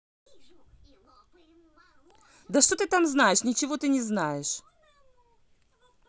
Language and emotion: Russian, angry